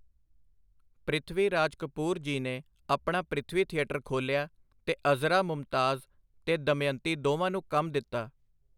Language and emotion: Punjabi, neutral